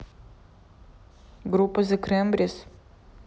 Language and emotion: Russian, neutral